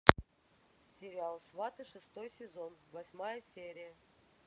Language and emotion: Russian, neutral